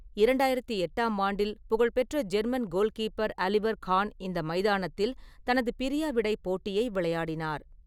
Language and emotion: Tamil, neutral